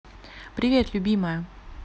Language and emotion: Russian, neutral